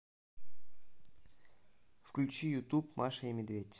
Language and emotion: Russian, neutral